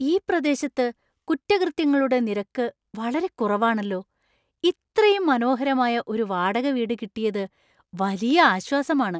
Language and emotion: Malayalam, surprised